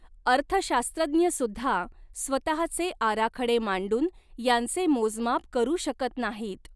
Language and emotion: Marathi, neutral